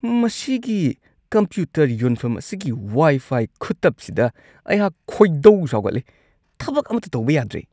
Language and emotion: Manipuri, disgusted